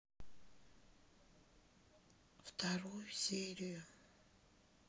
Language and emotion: Russian, sad